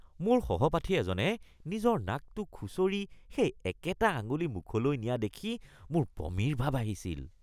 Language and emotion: Assamese, disgusted